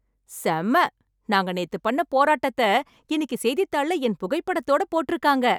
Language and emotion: Tamil, happy